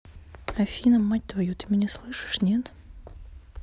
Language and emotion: Russian, neutral